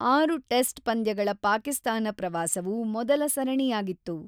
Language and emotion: Kannada, neutral